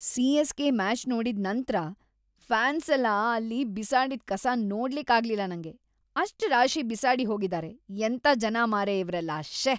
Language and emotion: Kannada, disgusted